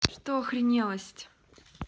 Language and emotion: Russian, angry